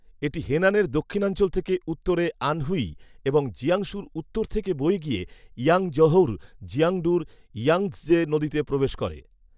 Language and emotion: Bengali, neutral